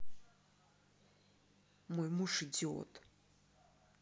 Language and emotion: Russian, angry